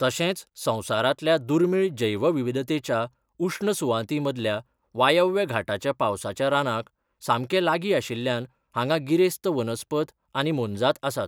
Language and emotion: Goan Konkani, neutral